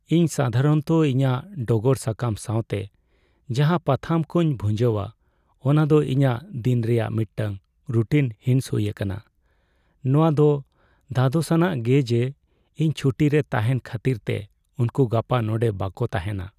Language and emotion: Santali, sad